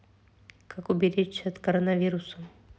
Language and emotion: Russian, neutral